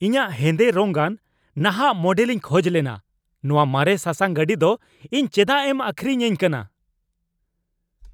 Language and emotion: Santali, angry